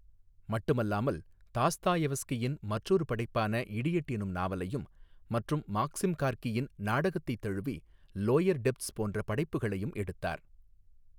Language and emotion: Tamil, neutral